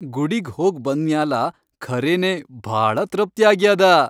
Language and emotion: Kannada, happy